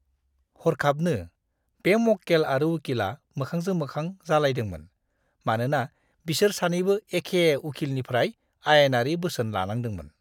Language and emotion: Bodo, disgusted